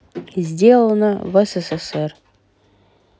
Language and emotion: Russian, neutral